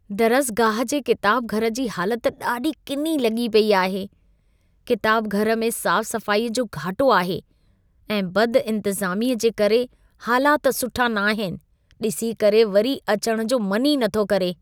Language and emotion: Sindhi, disgusted